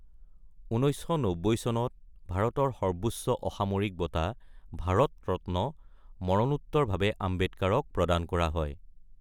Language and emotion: Assamese, neutral